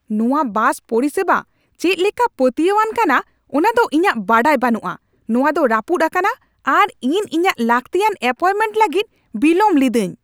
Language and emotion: Santali, angry